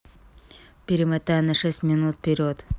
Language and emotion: Russian, neutral